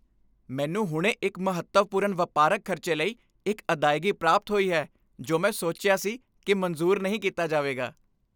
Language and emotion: Punjabi, happy